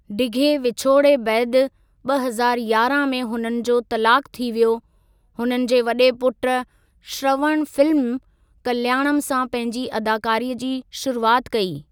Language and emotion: Sindhi, neutral